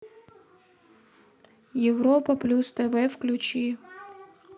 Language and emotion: Russian, neutral